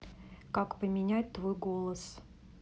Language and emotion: Russian, neutral